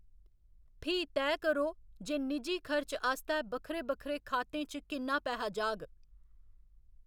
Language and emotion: Dogri, neutral